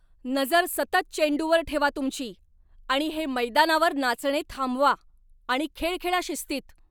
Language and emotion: Marathi, angry